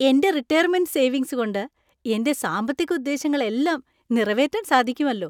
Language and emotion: Malayalam, happy